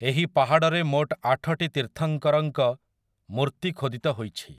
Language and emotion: Odia, neutral